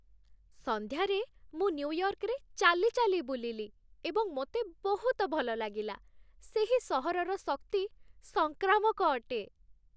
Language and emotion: Odia, happy